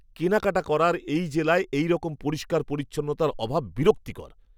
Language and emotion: Bengali, disgusted